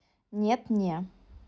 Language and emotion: Russian, neutral